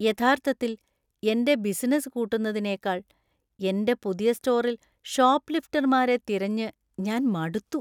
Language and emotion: Malayalam, disgusted